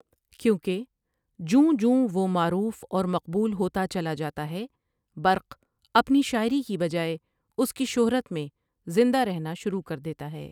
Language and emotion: Urdu, neutral